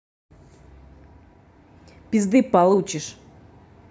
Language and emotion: Russian, angry